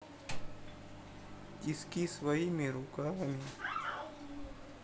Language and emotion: Russian, sad